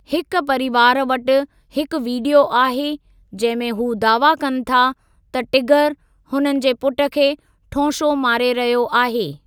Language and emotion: Sindhi, neutral